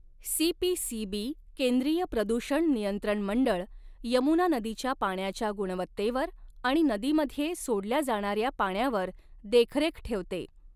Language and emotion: Marathi, neutral